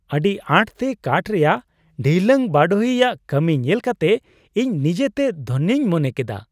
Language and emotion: Santali, happy